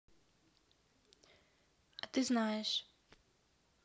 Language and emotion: Russian, neutral